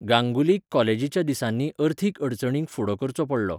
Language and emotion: Goan Konkani, neutral